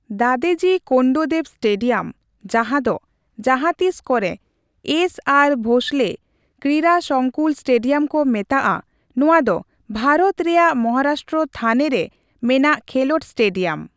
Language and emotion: Santali, neutral